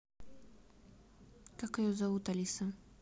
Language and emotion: Russian, neutral